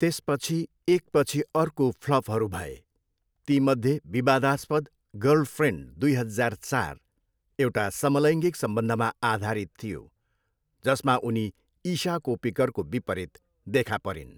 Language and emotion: Nepali, neutral